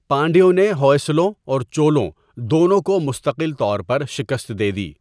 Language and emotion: Urdu, neutral